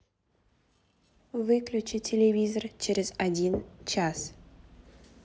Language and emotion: Russian, neutral